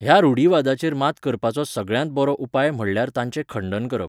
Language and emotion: Goan Konkani, neutral